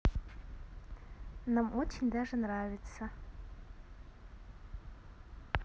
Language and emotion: Russian, positive